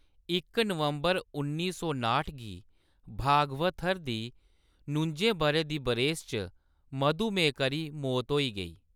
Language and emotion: Dogri, neutral